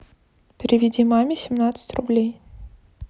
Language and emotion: Russian, neutral